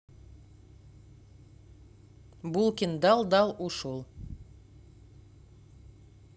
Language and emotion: Russian, neutral